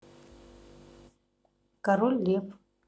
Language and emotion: Russian, neutral